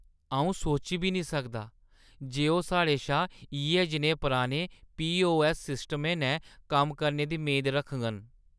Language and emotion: Dogri, disgusted